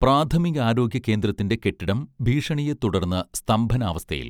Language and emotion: Malayalam, neutral